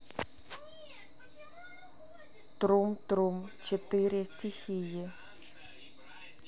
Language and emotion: Russian, neutral